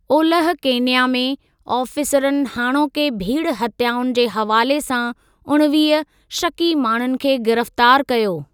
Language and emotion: Sindhi, neutral